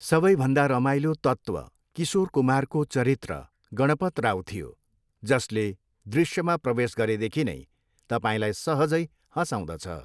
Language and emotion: Nepali, neutral